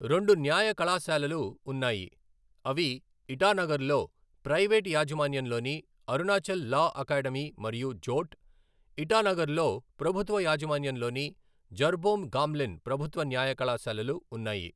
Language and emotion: Telugu, neutral